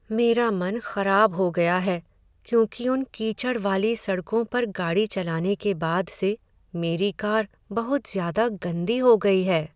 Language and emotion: Hindi, sad